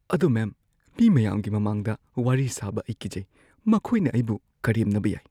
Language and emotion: Manipuri, fearful